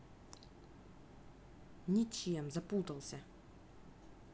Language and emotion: Russian, angry